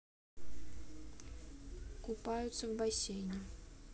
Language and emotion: Russian, neutral